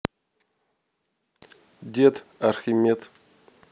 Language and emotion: Russian, neutral